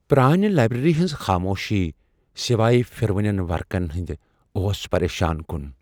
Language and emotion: Kashmiri, fearful